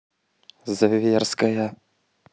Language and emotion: Russian, neutral